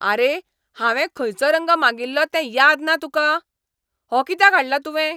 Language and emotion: Goan Konkani, angry